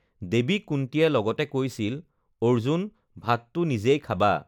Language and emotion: Assamese, neutral